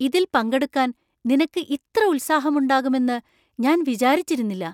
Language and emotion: Malayalam, surprised